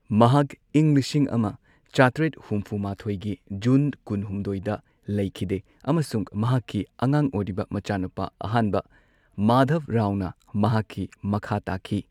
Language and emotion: Manipuri, neutral